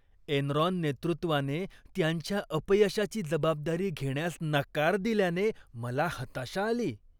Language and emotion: Marathi, disgusted